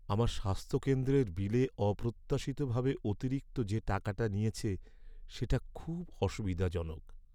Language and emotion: Bengali, sad